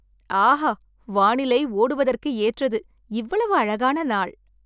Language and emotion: Tamil, happy